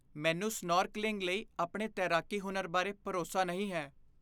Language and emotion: Punjabi, fearful